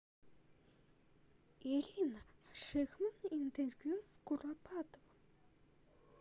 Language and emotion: Russian, neutral